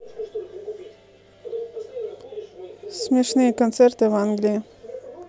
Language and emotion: Russian, neutral